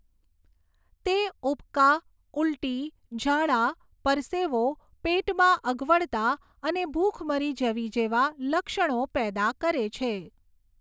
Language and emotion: Gujarati, neutral